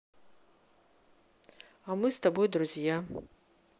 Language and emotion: Russian, neutral